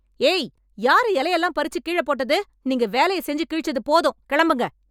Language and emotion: Tamil, angry